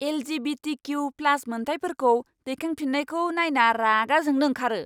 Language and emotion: Bodo, angry